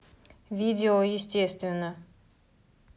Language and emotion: Russian, neutral